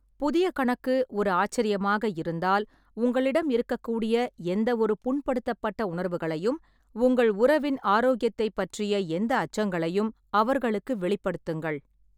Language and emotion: Tamil, neutral